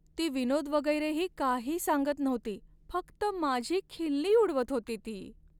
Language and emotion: Marathi, sad